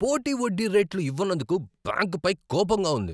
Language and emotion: Telugu, angry